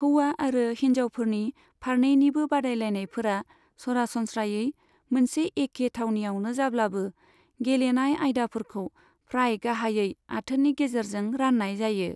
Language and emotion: Bodo, neutral